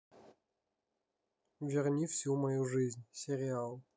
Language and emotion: Russian, neutral